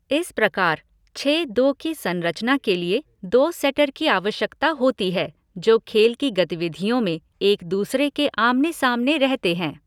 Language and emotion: Hindi, neutral